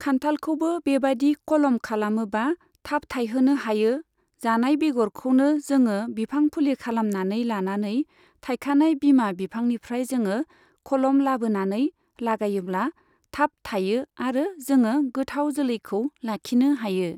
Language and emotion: Bodo, neutral